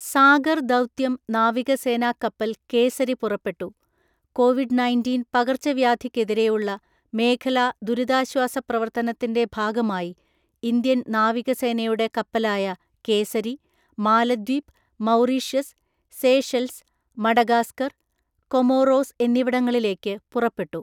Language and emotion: Malayalam, neutral